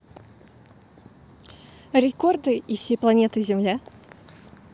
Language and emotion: Russian, positive